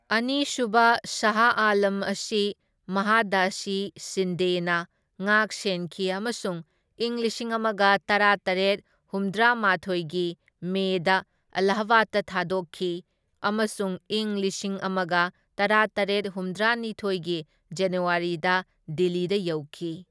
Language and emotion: Manipuri, neutral